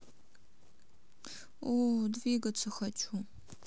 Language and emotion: Russian, sad